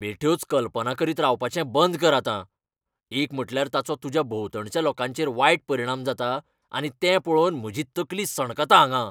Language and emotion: Goan Konkani, angry